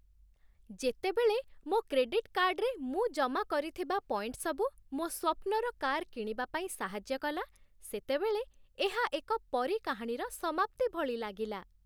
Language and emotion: Odia, happy